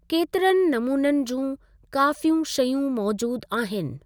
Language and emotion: Sindhi, neutral